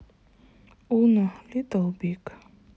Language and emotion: Russian, sad